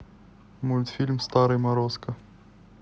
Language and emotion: Russian, neutral